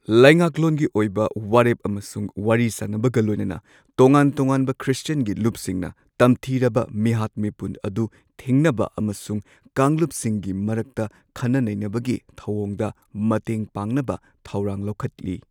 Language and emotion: Manipuri, neutral